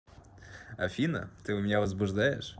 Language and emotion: Russian, positive